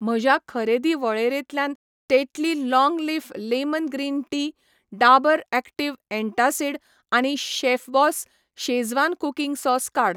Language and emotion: Goan Konkani, neutral